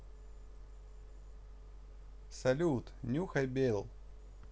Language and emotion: Russian, positive